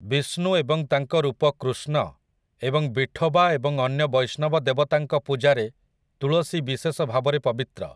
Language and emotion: Odia, neutral